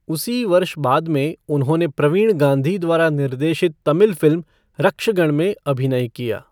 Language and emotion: Hindi, neutral